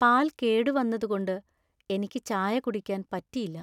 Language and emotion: Malayalam, sad